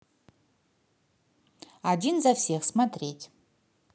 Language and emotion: Russian, positive